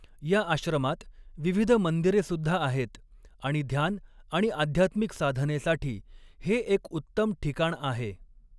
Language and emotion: Marathi, neutral